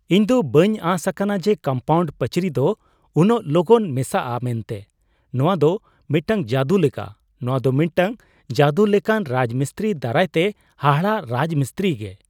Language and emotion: Santali, surprised